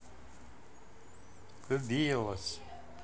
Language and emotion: Russian, positive